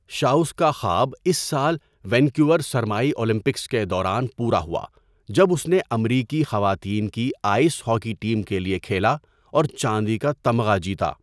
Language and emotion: Urdu, neutral